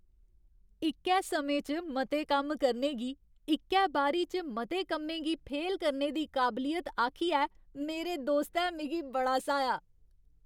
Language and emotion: Dogri, happy